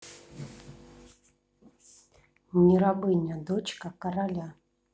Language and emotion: Russian, neutral